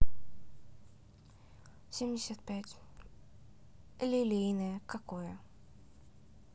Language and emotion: Russian, neutral